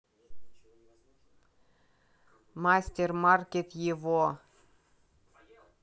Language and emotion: Russian, neutral